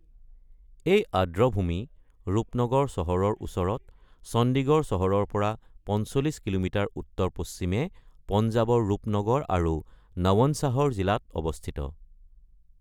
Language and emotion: Assamese, neutral